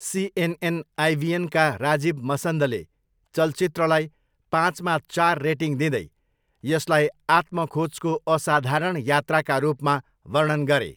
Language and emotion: Nepali, neutral